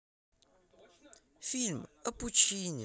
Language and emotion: Russian, positive